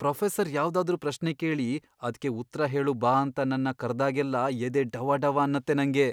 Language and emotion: Kannada, fearful